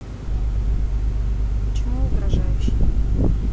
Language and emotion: Russian, neutral